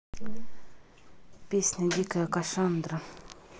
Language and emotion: Russian, neutral